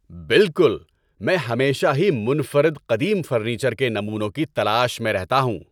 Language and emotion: Urdu, happy